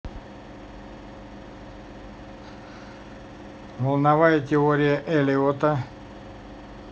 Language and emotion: Russian, neutral